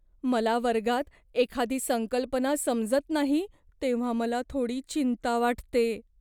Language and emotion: Marathi, fearful